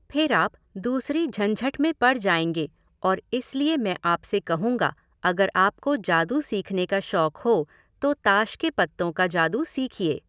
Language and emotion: Hindi, neutral